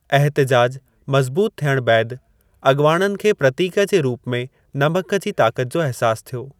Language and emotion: Sindhi, neutral